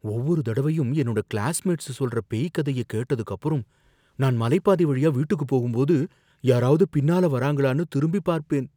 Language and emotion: Tamil, fearful